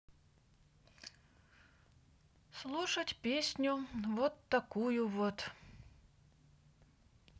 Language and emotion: Russian, sad